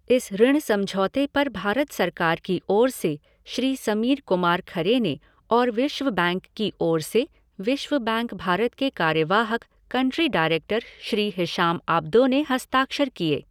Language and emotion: Hindi, neutral